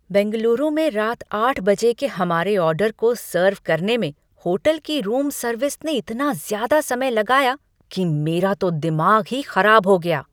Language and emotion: Hindi, angry